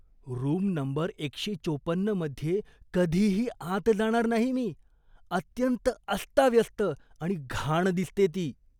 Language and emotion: Marathi, disgusted